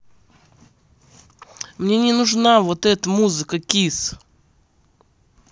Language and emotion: Russian, angry